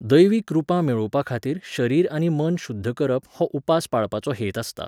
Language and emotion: Goan Konkani, neutral